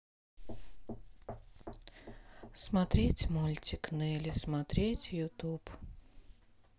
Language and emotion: Russian, neutral